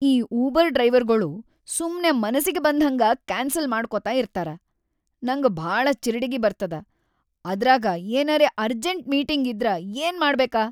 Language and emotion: Kannada, angry